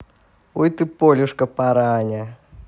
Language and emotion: Russian, positive